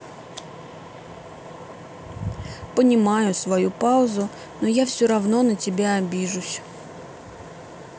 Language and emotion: Russian, sad